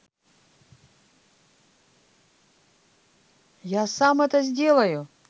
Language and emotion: Russian, positive